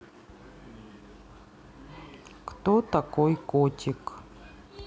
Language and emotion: Russian, neutral